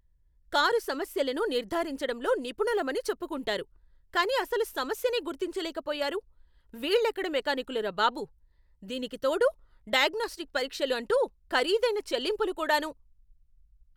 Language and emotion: Telugu, angry